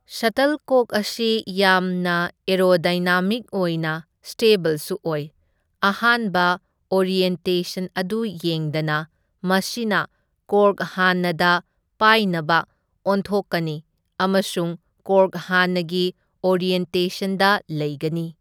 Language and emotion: Manipuri, neutral